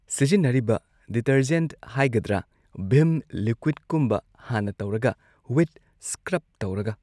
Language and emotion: Manipuri, neutral